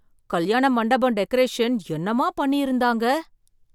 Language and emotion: Tamil, surprised